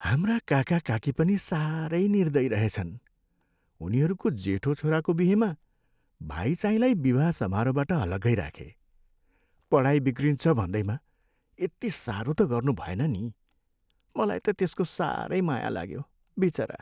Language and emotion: Nepali, sad